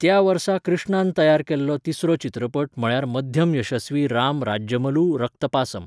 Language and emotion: Goan Konkani, neutral